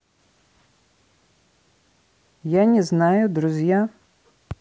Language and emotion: Russian, neutral